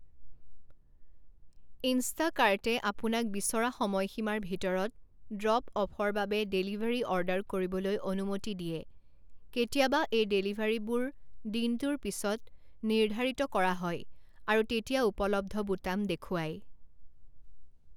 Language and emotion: Assamese, neutral